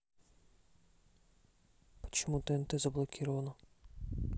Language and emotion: Russian, neutral